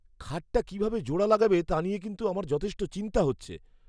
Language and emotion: Bengali, fearful